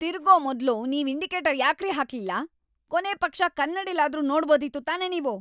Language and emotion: Kannada, angry